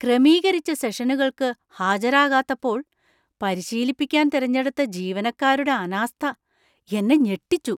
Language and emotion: Malayalam, surprised